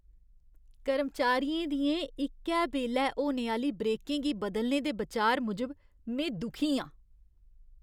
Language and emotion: Dogri, disgusted